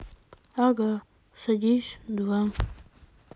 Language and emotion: Russian, sad